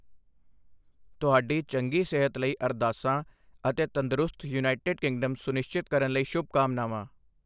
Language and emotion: Punjabi, neutral